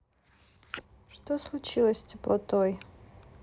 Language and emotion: Russian, sad